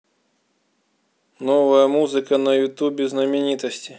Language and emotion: Russian, neutral